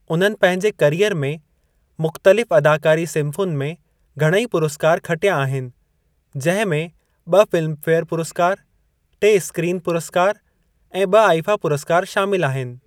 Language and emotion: Sindhi, neutral